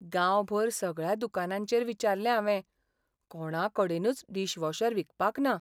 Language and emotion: Goan Konkani, sad